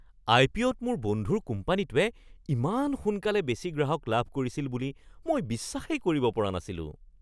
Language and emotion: Assamese, surprised